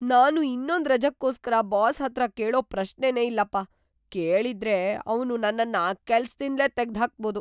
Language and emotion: Kannada, fearful